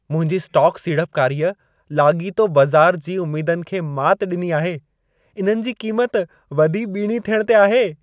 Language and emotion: Sindhi, happy